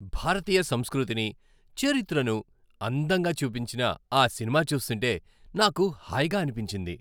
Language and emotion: Telugu, happy